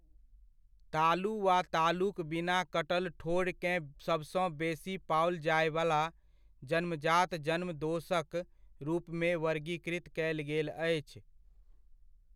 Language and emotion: Maithili, neutral